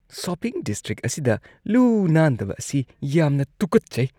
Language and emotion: Manipuri, disgusted